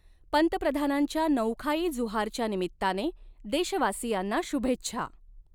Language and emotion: Marathi, neutral